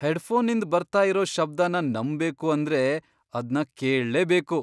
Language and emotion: Kannada, surprised